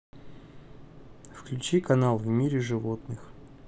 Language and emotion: Russian, neutral